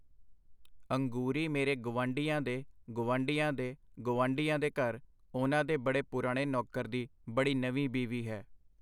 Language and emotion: Punjabi, neutral